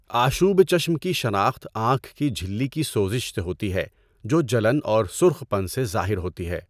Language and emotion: Urdu, neutral